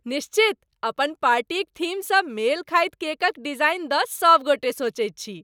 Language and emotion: Maithili, happy